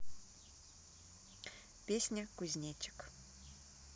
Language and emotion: Russian, neutral